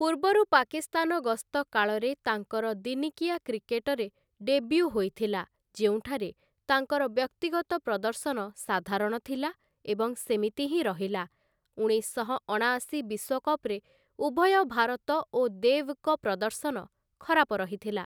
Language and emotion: Odia, neutral